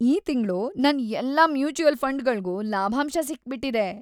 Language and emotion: Kannada, happy